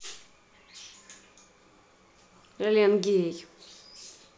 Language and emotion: Russian, neutral